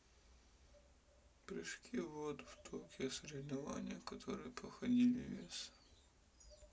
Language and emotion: Russian, sad